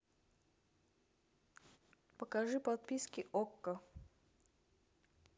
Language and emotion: Russian, neutral